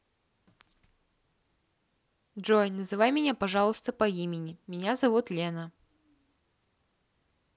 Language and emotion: Russian, neutral